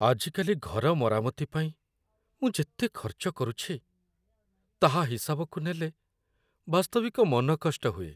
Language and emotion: Odia, sad